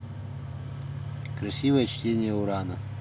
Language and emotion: Russian, neutral